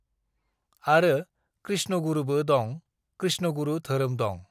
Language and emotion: Bodo, neutral